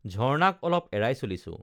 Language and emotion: Assamese, neutral